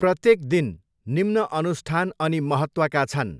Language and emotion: Nepali, neutral